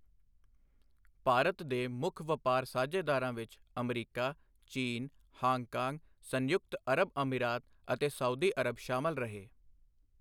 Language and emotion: Punjabi, neutral